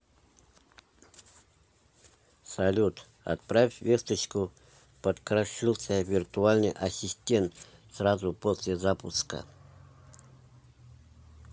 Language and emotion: Russian, neutral